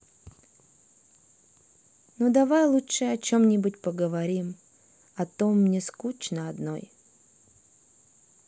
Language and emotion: Russian, sad